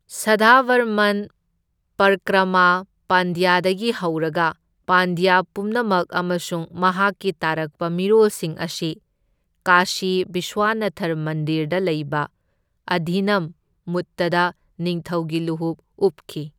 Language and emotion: Manipuri, neutral